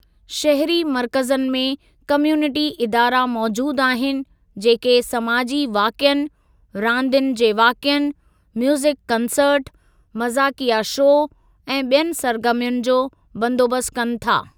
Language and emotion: Sindhi, neutral